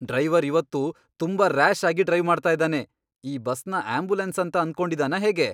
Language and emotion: Kannada, angry